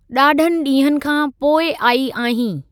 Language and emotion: Sindhi, neutral